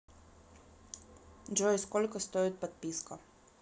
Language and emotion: Russian, neutral